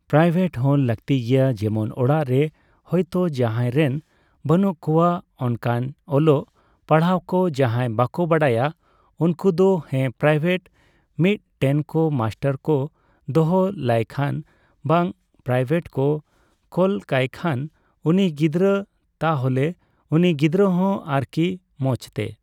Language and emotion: Santali, neutral